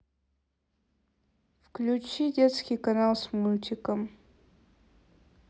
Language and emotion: Russian, neutral